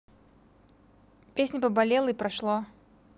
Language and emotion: Russian, neutral